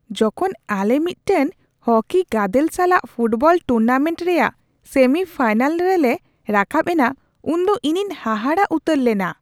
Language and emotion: Santali, surprised